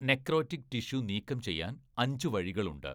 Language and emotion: Malayalam, neutral